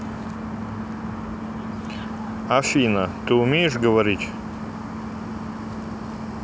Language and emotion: Russian, neutral